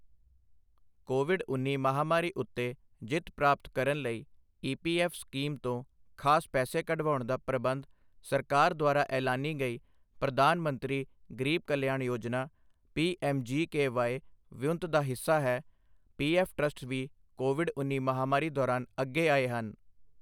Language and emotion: Punjabi, neutral